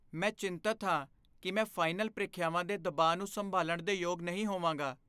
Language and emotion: Punjabi, fearful